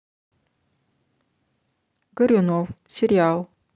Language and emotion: Russian, neutral